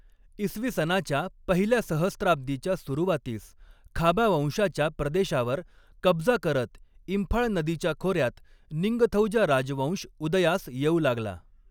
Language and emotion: Marathi, neutral